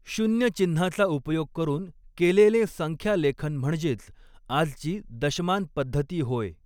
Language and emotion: Marathi, neutral